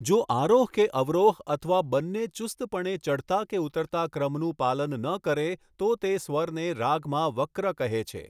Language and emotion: Gujarati, neutral